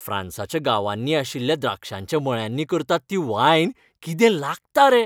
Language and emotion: Goan Konkani, happy